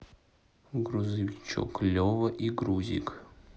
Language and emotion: Russian, neutral